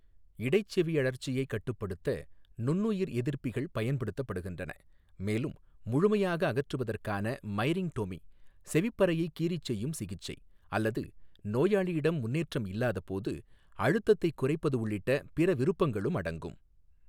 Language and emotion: Tamil, neutral